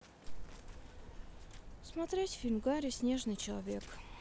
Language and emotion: Russian, sad